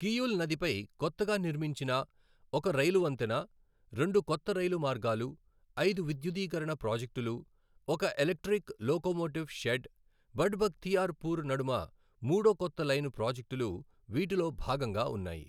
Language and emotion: Telugu, neutral